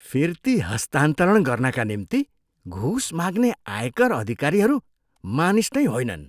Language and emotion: Nepali, disgusted